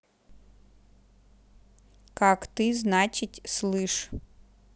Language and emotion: Russian, neutral